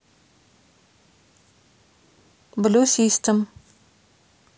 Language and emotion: Russian, neutral